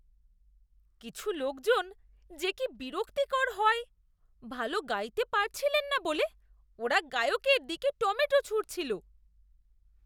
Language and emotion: Bengali, disgusted